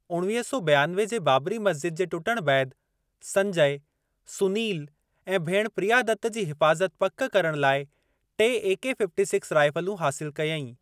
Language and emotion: Sindhi, neutral